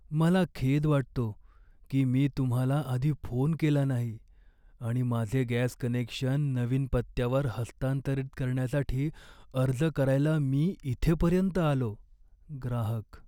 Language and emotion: Marathi, sad